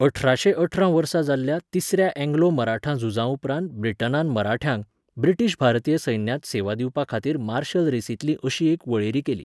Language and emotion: Goan Konkani, neutral